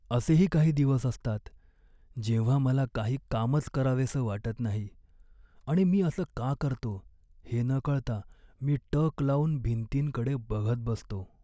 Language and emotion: Marathi, sad